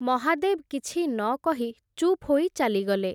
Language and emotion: Odia, neutral